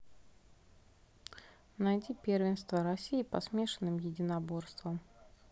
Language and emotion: Russian, neutral